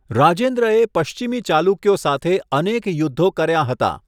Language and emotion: Gujarati, neutral